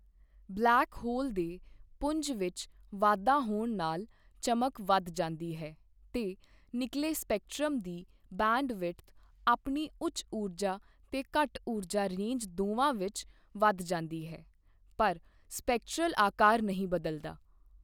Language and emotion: Punjabi, neutral